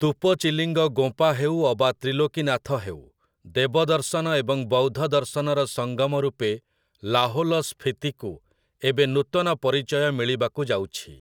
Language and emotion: Odia, neutral